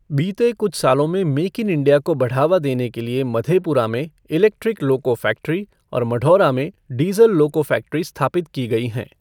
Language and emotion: Hindi, neutral